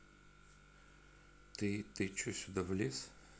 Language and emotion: Russian, neutral